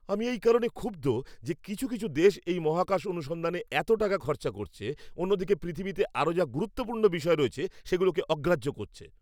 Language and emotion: Bengali, angry